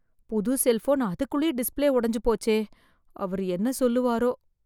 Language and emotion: Tamil, fearful